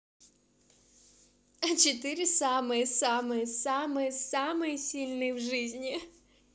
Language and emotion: Russian, positive